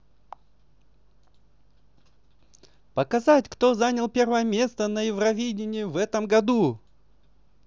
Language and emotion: Russian, positive